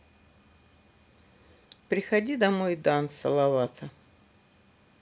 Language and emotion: Russian, neutral